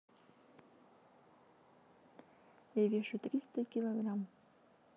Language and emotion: Russian, neutral